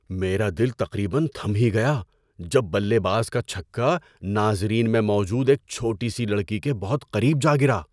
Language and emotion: Urdu, surprised